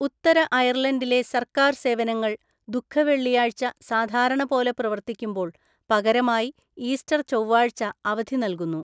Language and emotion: Malayalam, neutral